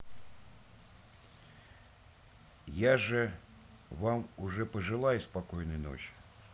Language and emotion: Russian, neutral